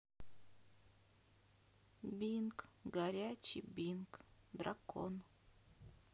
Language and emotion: Russian, sad